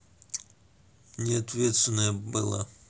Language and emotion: Russian, neutral